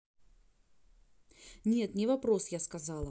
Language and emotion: Russian, neutral